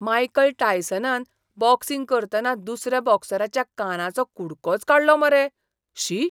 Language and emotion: Goan Konkani, disgusted